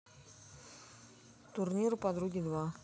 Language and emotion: Russian, neutral